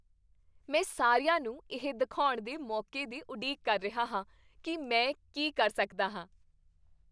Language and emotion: Punjabi, happy